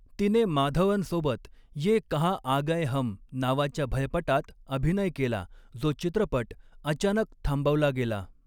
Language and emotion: Marathi, neutral